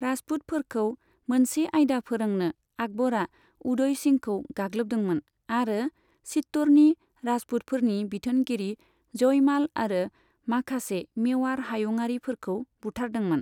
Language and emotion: Bodo, neutral